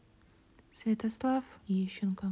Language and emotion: Russian, neutral